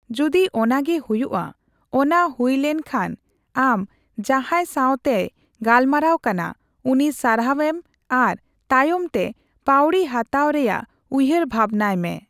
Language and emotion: Santali, neutral